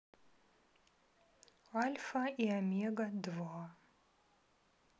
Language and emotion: Russian, neutral